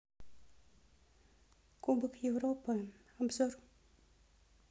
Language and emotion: Russian, neutral